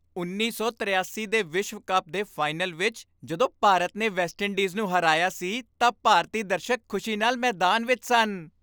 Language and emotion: Punjabi, happy